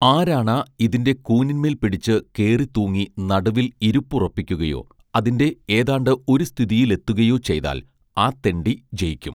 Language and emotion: Malayalam, neutral